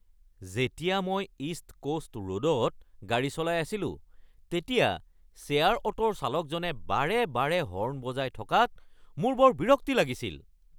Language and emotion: Assamese, angry